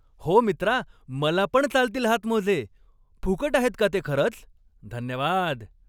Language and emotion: Marathi, happy